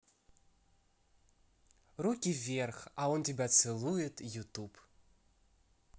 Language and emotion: Russian, positive